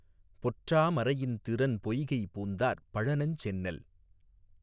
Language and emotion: Tamil, neutral